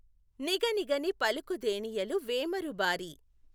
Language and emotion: Telugu, neutral